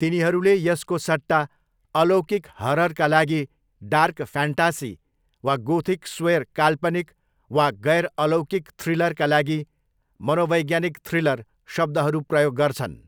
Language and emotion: Nepali, neutral